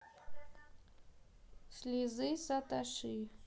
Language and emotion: Russian, neutral